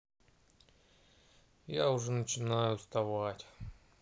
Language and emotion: Russian, neutral